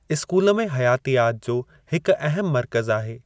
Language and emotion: Sindhi, neutral